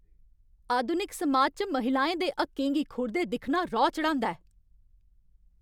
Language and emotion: Dogri, angry